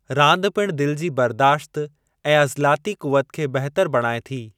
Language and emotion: Sindhi, neutral